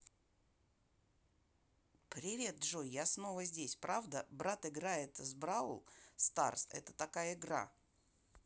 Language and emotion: Russian, positive